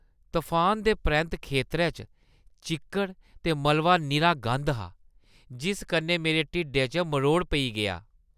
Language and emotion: Dogri, disgusted